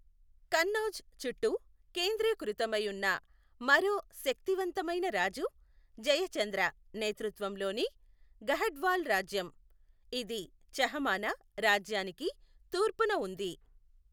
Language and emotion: Telugu, neutral